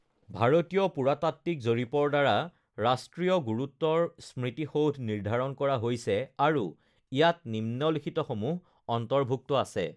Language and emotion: Assamese, neutral